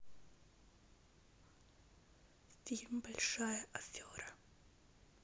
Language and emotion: Russian, neutral